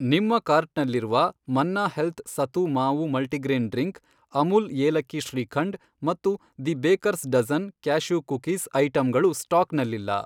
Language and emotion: Kannada, neutral